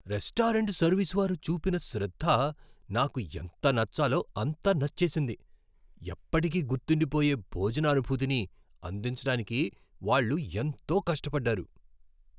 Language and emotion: Telugu, surprised